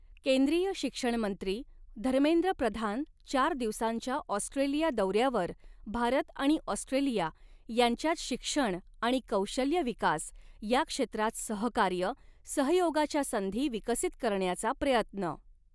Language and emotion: Marathi, neutral